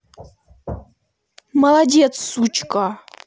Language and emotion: Russian, angry